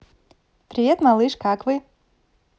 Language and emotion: Russian, positive